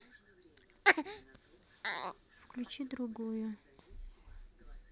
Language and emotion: Russian, neutral